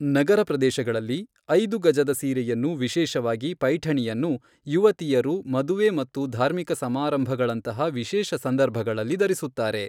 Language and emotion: Kannada, neutral